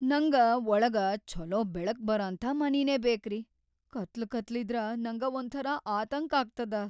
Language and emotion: Kannada, fearful